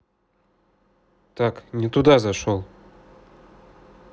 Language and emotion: Russian, neutral